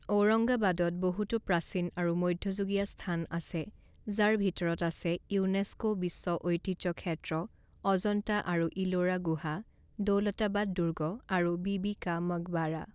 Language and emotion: Assamese, neutral